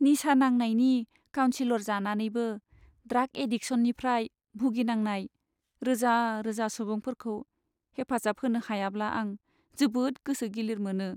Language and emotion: Bodo, sad